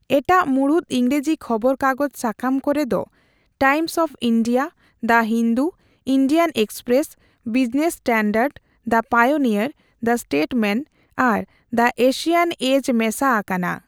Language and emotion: Santali, neutral